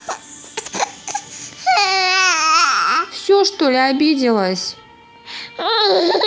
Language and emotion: Russian, neutral